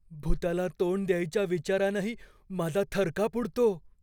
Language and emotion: Marathi, fearful